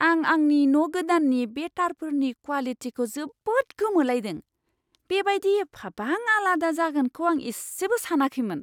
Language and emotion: Bodo, surprised